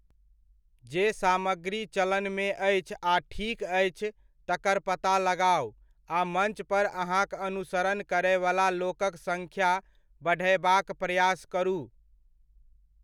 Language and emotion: Maithili, neutral